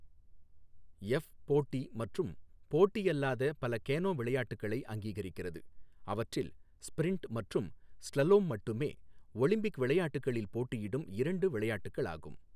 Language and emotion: Tamil, neutral